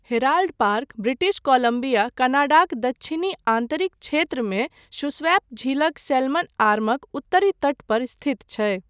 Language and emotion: Maithili, neutral